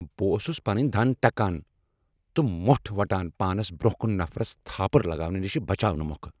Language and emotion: Kashmiri, angry